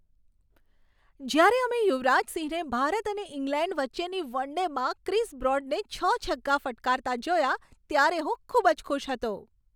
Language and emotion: Gujarati, happy